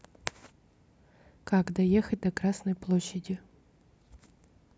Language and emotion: Russian, neutral